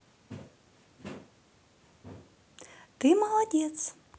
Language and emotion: Russian, positive